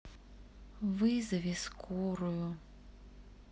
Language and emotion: Russian, sad